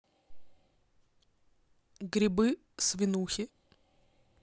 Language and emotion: Russian, neutral